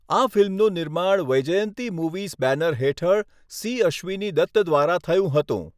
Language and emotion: Gujarati, neutral